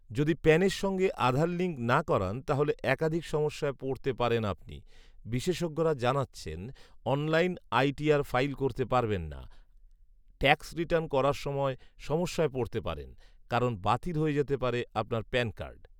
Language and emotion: Bengali, neutral